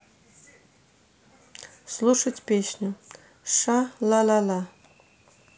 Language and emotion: Russian, neutral